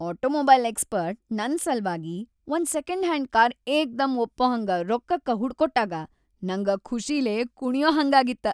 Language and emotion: Kannada, happy